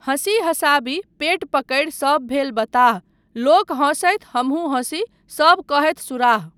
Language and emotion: Maithili, neutral